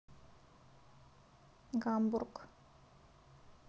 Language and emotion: Russian, neutral